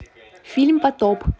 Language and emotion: Russian, neutral